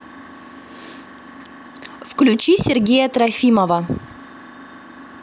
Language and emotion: Russian, neutral